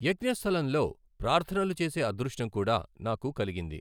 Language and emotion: Telugu, neutral